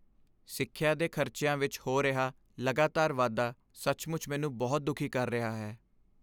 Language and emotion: Punjabi, sad